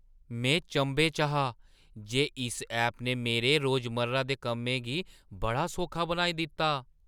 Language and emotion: Dogri, surprised